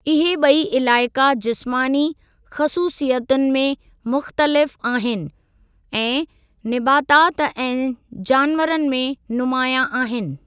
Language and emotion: Sindhi, neutral